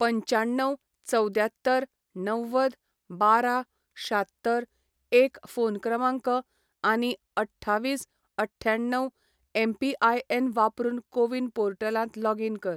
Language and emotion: Goan Konkani, neutral